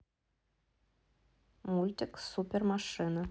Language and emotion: Russian, neutral